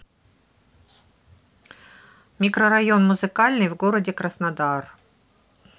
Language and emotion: Russian, neutral